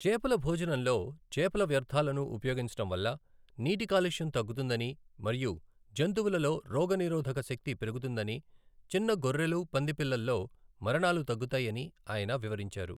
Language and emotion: Telugu, neutral